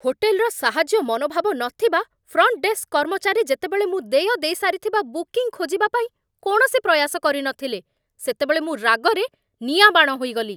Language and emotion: Odia, angry